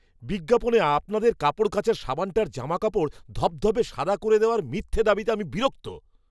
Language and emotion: Bengali, angry